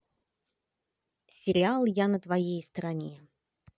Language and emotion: Russian, positive